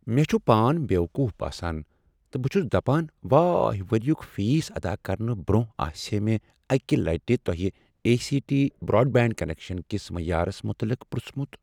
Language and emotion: Kashmiri, sad